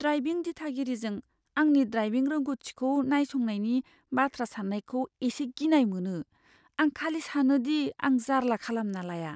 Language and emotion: Bodo, fearful